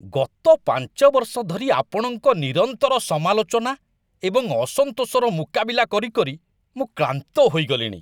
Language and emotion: Odia, disgusted